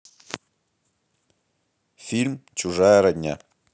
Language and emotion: Russian, neutral